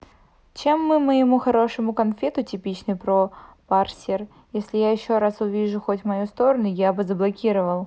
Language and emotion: Russian, neutral